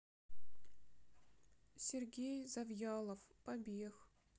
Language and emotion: Russian, sad